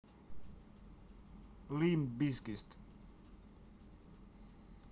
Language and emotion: Russian, neutral